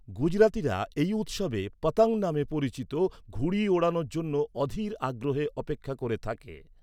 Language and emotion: Bengali, neutral